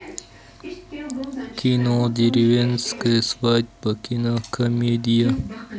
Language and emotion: Russian, neutral